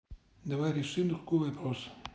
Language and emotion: Russian, neutral